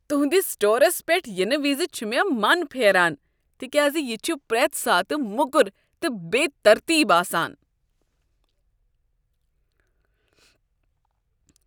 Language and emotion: Kashmiri, disgusted